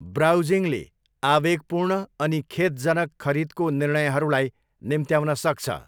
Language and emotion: Nepali, neutral